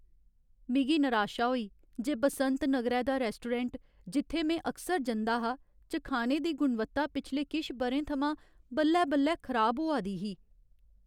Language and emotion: Dogri, sad